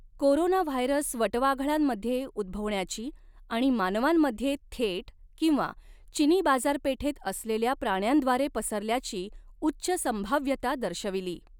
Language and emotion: Marathi, neutral